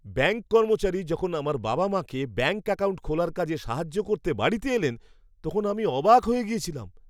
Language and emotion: Bengali, surprised